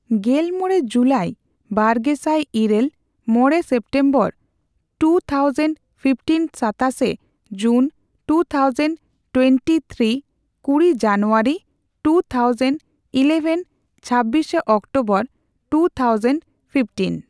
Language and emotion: Santali, neutral